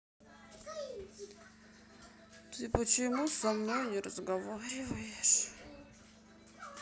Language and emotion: Russian, sad